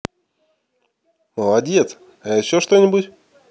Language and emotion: Russian, positive